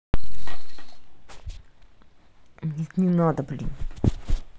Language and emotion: Russian, angry